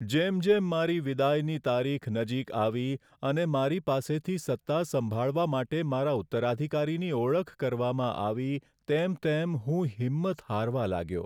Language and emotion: Gujarati, sad